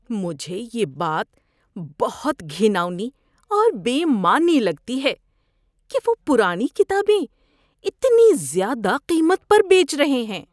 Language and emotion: Urdu, disgusted